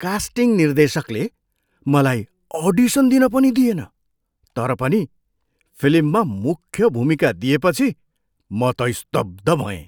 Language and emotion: Nepali, surprised